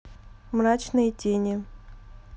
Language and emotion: Russian, neutral